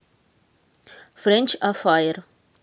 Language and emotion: Russian, neutral